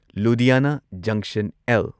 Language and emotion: Manipuri, neutral